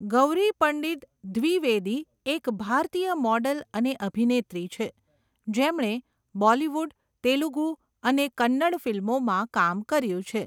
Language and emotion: Gujarati, neutral